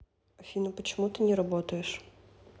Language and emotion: Russian, neutral